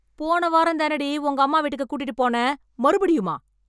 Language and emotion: Tamil, angry